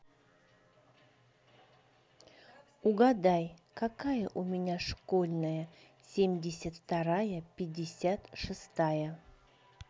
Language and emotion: Russian, neutral